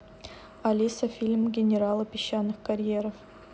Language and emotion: Russian, neutral